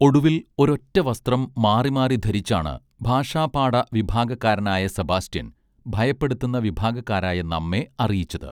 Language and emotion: Malayalam, neutral